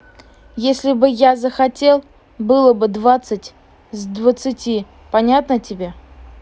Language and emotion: Russian, neutral